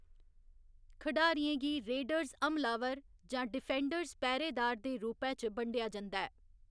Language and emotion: Dogri, neutral